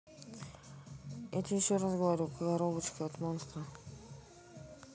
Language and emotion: Russian, neutral